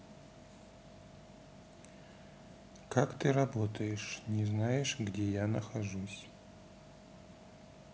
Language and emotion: Russian, neutral